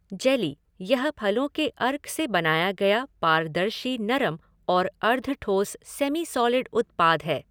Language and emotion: Hindi, neutral